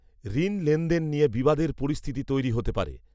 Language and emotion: Bengali, neutral